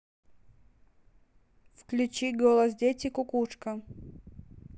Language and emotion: Russian, neutral